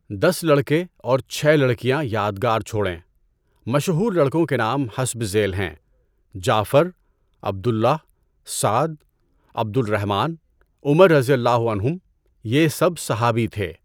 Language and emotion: Urdu, neutral